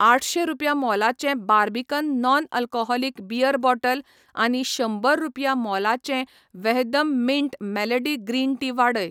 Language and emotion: Goan Konkani, neutral